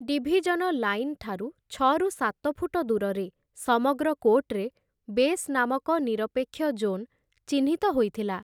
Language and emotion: Odia, neutral